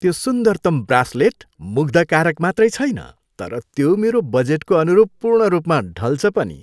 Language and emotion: Nepali, happy